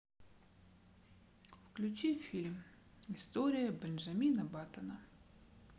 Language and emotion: Russian, sad